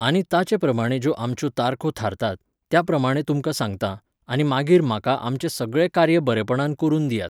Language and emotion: Goan Konkani, neutral